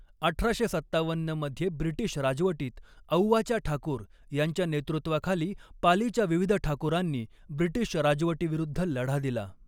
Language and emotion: Marathi, neutral